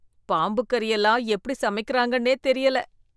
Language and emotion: Tamil, disgusted